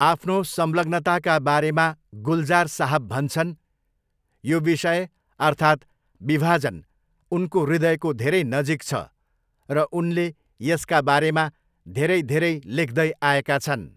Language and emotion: Nepali, neutral